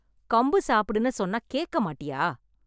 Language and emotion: Tamil, angry